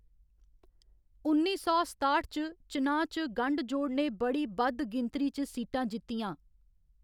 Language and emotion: Dogri, neutral